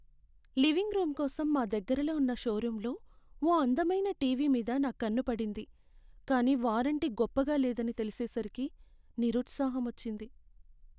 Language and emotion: Telugu, sad